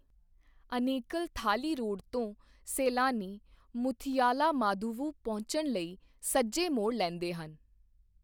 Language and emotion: Punjabi, neutral